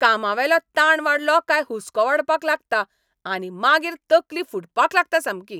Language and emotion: Goan Konkani, angry